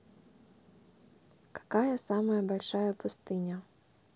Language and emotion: Russian, neutral